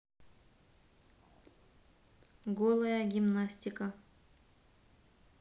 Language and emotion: Russian, neutral